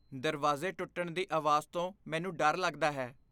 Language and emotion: Punjabi, fearful